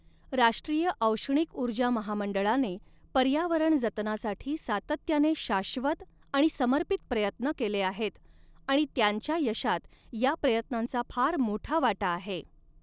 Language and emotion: Marathi, neutral